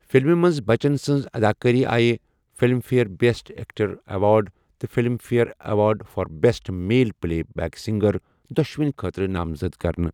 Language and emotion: Kashmiri, neutral